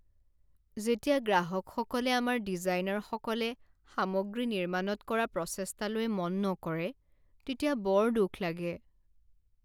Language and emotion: Assamese, sad